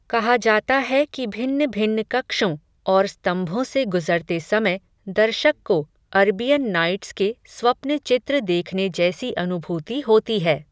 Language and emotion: Hindi, neutral